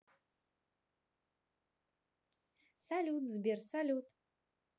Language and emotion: Russian, positive